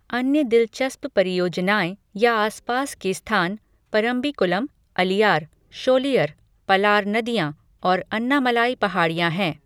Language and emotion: Hindi, neutral